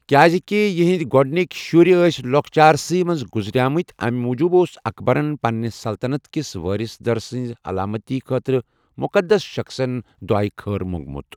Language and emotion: Kashmiri, neutral